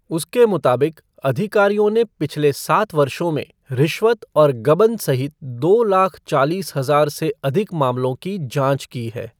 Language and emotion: Hindi, neutral